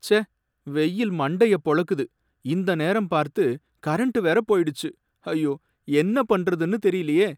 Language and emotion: Tamil, sad